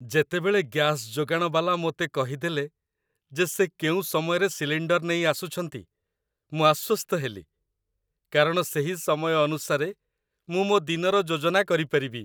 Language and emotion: Odia, happy